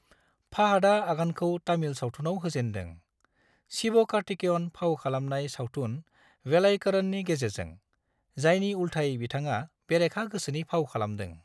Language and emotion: Bodo, neutral